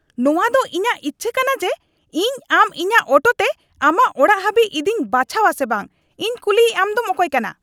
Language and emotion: Santali, angry